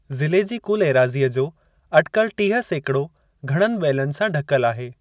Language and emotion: Sindhi, neutral